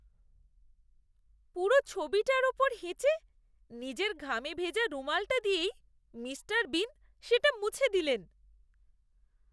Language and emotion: Bengali, disgusted